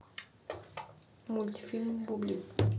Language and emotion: Russian, neutral